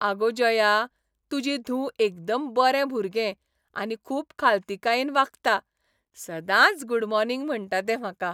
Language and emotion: Goan Konkani, happy